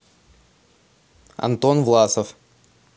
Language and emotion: Russian, neutral